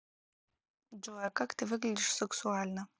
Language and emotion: Russian, neutral